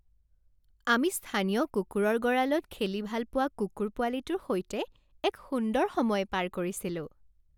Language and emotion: Assamese, happy